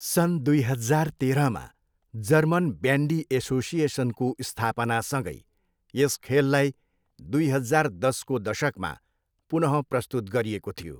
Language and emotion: Nepali, neutral